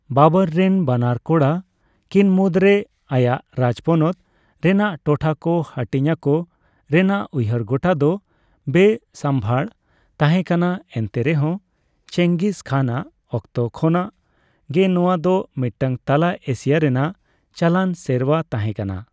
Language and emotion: Santali, neutral